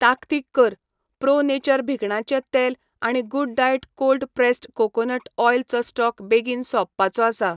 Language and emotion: Goan Konkani, neutral